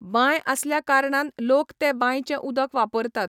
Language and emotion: Goan Konkani, neutral